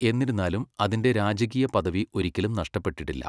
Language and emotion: Malayalam, neutral